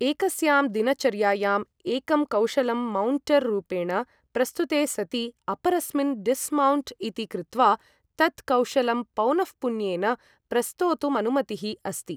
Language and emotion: Sanskrit, neutral